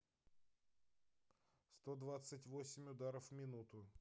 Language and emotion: Russian, neutral